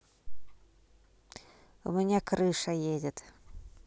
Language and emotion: Russian, neutral